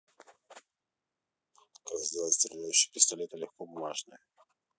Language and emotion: Russian, neutral